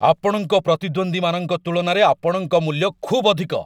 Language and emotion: Odia, angry